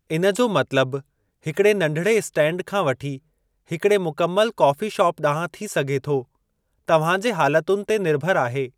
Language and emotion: Sindhi, neutral